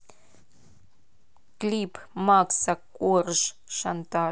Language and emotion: Russian, neutral